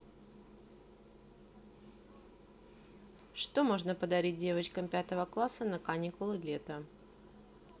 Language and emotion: Russian, neutral